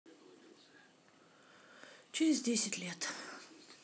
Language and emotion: Russian, sad